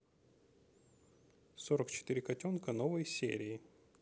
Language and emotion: Russian, neutral